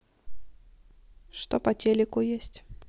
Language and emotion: Russian, neutral